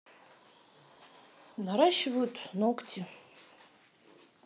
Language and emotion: Russian, neutral